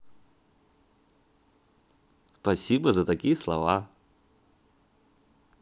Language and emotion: Russian, positive